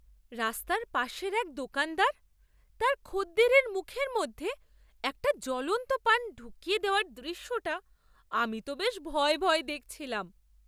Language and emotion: Bengali, surprised